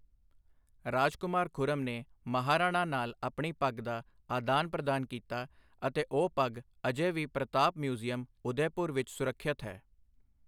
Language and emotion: Punjabi, neutral